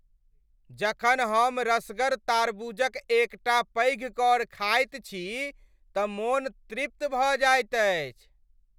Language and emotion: Maithili, happy